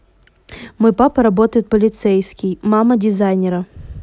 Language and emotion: Russian, neutral